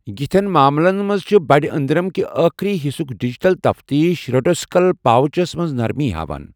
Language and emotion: Kashmiri, neutral